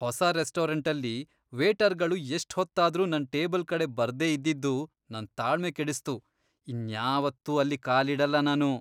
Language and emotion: Kannada, disgusted